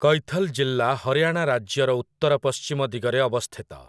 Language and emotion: Odia, neutral